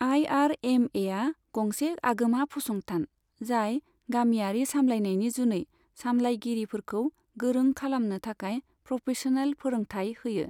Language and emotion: Bodo, neutral